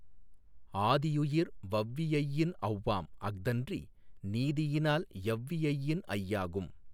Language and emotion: Tamil, neutral